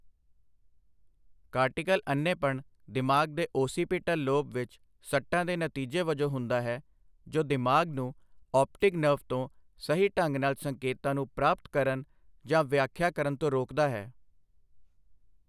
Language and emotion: Punjabi, neutral